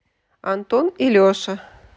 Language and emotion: Russian, positive